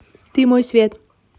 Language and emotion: Russian, neutral